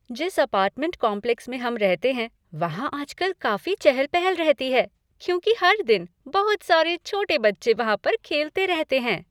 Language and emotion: Hindi, happy